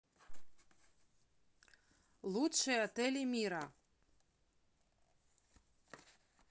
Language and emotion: Russian, neutral